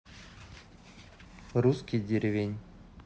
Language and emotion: Russian, neutral